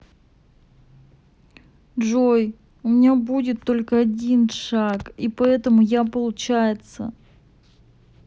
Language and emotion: Russian, sad